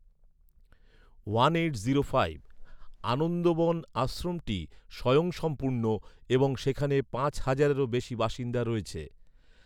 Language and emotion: Bengali, neutral